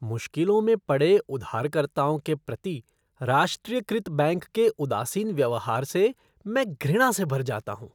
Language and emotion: Hindi, disgusted